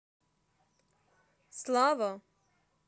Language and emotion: Russian, angry